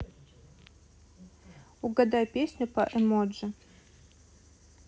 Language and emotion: Russian, neutral